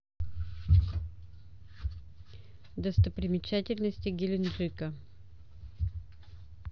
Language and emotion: Russian, neutral